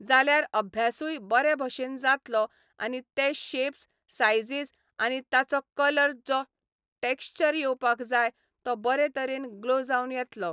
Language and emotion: Goan Konkani, neutral